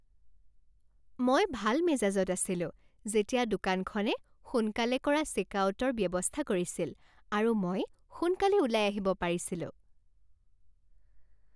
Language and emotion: Assamese, happy